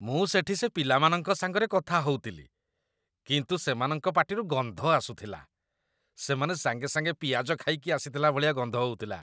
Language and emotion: Odia, disgusted